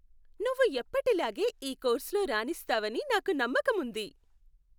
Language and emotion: Telugu, happy